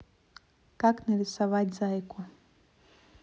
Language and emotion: Russian, neutral